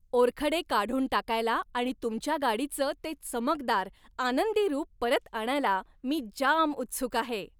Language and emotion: Marathi, happy